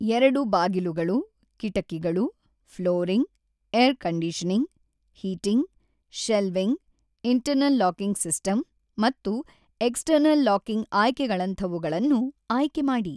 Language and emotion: Kannada, neutral